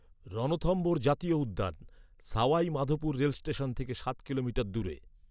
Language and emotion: Bengali, neutral